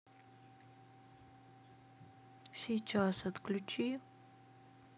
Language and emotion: Russian, sad